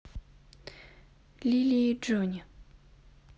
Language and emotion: Russian, neutral